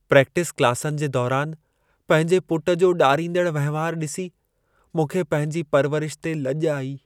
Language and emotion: Sindhi, sad